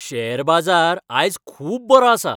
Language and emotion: Goan Konkani, happy